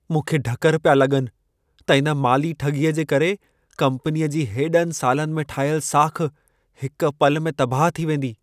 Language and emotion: Sindhi, fearful